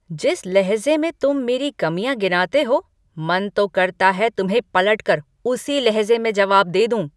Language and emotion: Hindi, angry